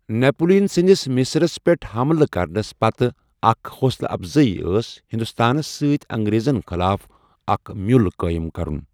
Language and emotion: Kashmiri, neutral